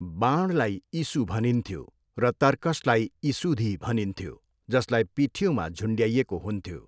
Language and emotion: Nepali, neutral